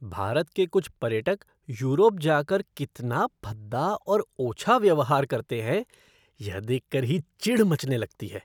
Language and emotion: Hindi, disgusted